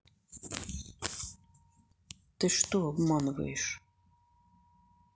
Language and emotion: Russian, angry